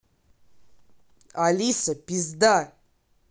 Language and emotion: Russian, angry